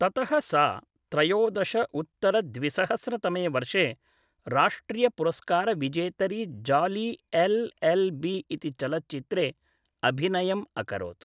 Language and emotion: Sanskrit, neutral